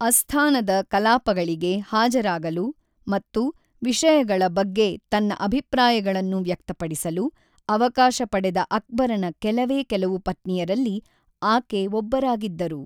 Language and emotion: Kannada, neutral